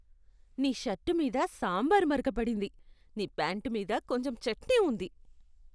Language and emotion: Telugu, disgusted